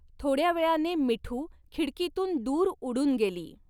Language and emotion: Marathi, neutral